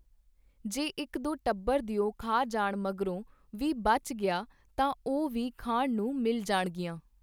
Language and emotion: Punjabi, neutral